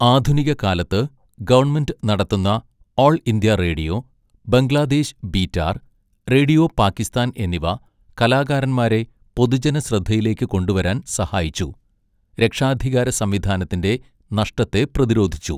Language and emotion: Malayalam, neutral